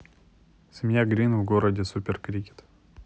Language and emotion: Russian, neutral